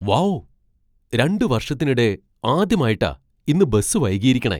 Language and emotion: Malayalam, surprised